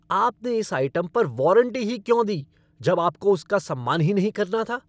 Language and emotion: Hindi, angry